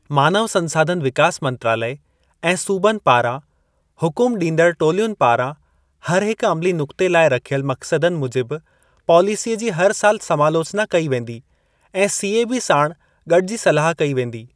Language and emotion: Sindhi, neutral